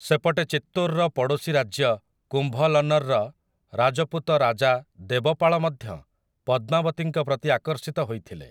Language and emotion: Odia, neutral